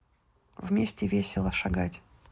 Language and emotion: Russian, neutral